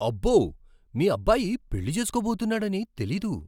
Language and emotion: Telugu, surprised